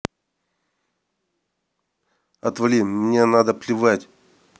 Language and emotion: Russian, angry